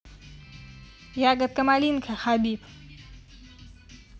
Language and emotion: Russian, positive